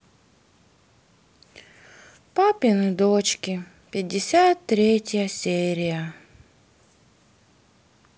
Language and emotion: Russian, sad